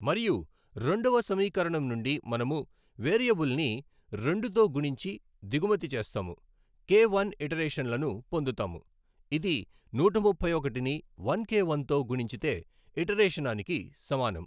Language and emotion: Telugu, neutral